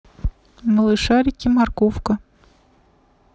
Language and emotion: Russian, neutral